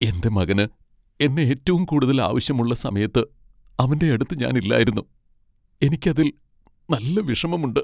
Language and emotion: Malayalam, sad